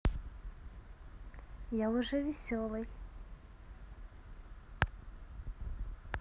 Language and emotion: Russian, positive